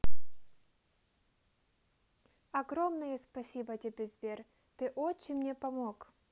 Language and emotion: Russian, positive